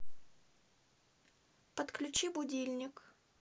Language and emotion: Russian, neutral